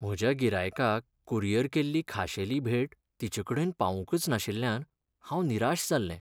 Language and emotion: Goan Konkani, sad